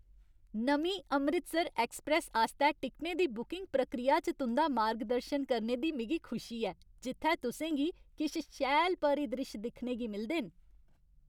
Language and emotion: Dogri, happy